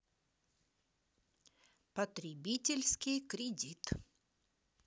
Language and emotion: Russian, neutral